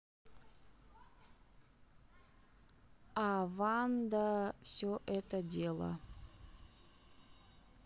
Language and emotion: Russian, neutral